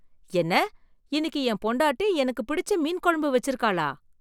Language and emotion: Tamil, surprised